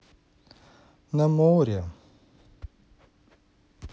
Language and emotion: Russian, neutral